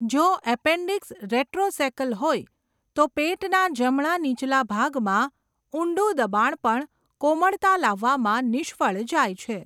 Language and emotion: Gujarati, neutral